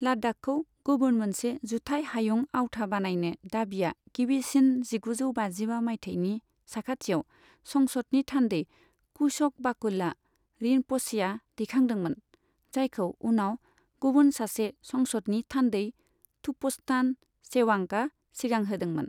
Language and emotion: Bodo, neutral